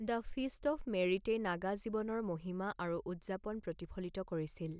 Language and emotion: Assamese, neutral